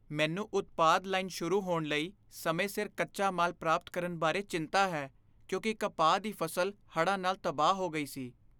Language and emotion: Punjabi, fearful